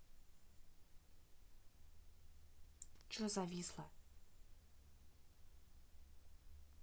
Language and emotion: Russian, angry